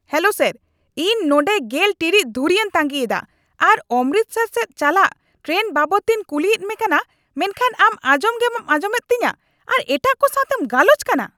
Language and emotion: Santali, angry